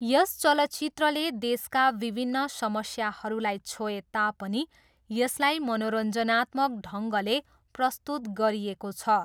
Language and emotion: Nepali, neutral